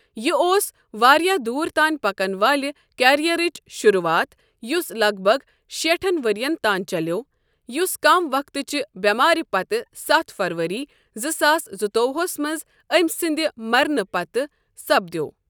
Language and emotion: Kashmiri, neutral